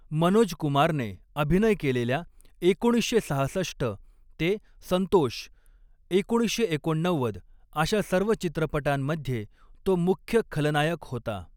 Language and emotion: Marathi, neutral